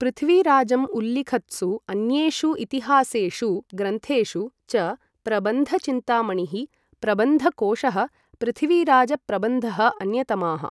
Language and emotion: Sanskrit, neutral